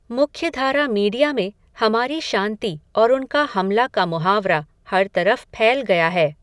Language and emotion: Hindi, neutral